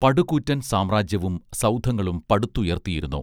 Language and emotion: Malayalam, neutral